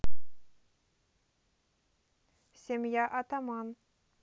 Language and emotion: Russian, neutral